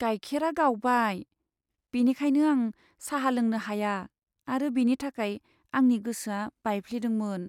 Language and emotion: Bodo, sad